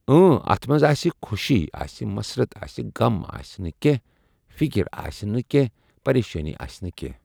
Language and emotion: Kashmiri, neutral